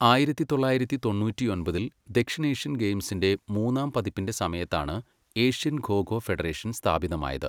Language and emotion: Malayalam, neutral